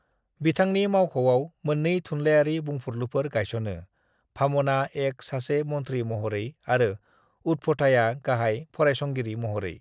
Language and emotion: Bodo, neutral